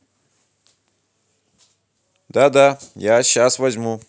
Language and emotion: Russian, positive